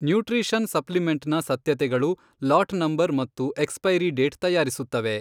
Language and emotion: Kannada, neutral